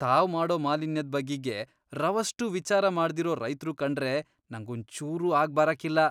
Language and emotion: Kannada, disgusted